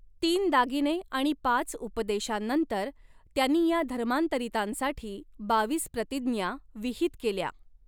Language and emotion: Marathi, neutral